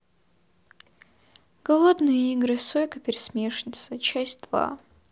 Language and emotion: Russian, sad